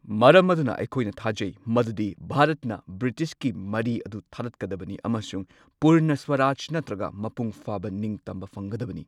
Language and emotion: Manipuri, neutral